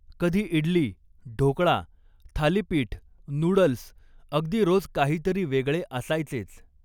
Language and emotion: Marathi, neutral